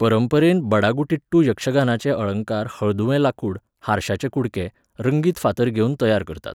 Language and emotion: Goan Konkani, neutral